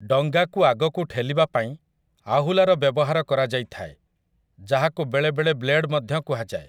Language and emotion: Odia, neutral